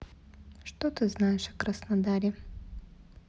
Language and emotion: Russian, neutral